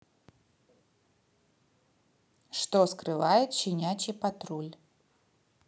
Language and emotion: Russian, neutral